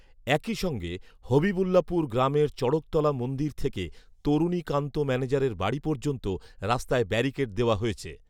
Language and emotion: Bengali, neutral